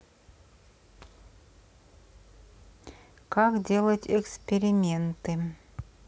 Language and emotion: Russian, neutral